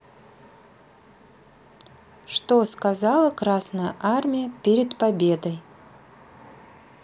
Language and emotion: Russian, neutral